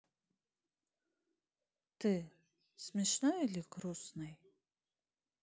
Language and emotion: Russian, neutral